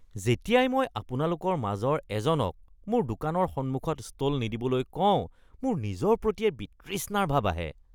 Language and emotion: Assamese, disgusted